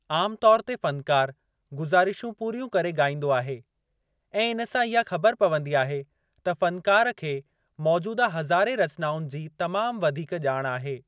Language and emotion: Sindhi, neutral